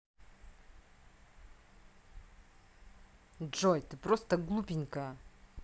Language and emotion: Russian, angry